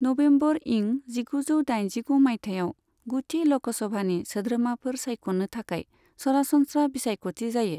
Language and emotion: Bodo, neutral